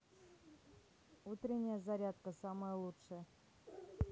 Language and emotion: Russian, neutral